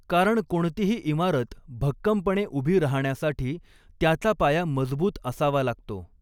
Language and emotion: Marathi, neutral